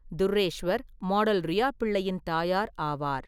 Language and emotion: Tamil, neutral